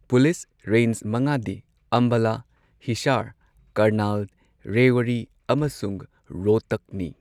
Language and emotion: Manipuri, neutral